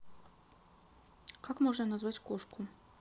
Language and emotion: Russian, neutral